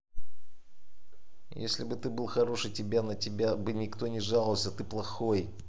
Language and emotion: Russian, angry